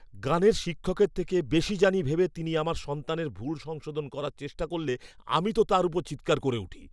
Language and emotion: Bengali, angry